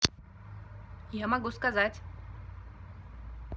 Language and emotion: Russian, neutral